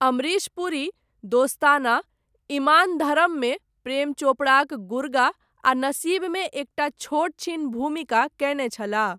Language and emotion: Maithili, neutral